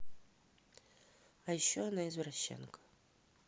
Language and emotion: Russian, neutral